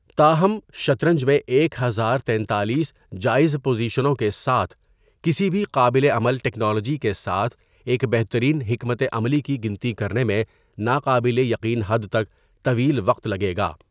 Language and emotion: Urdu, neutral